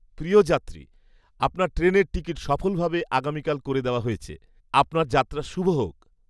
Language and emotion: Bengali, happy